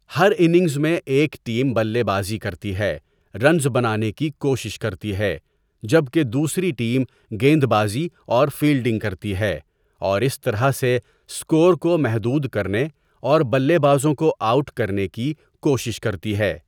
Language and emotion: Urdu, neutral